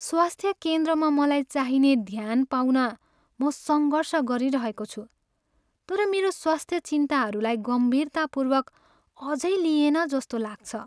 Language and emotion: Nepali, sad